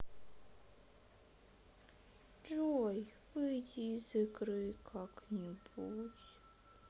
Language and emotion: Russian, sad